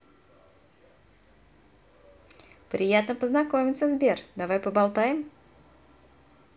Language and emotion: Russian, positive